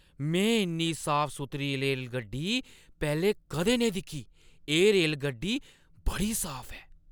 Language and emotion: Dogri, surprised